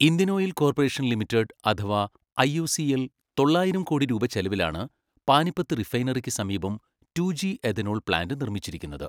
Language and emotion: Malayalam, neutral